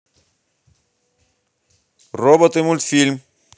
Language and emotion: Russian, positive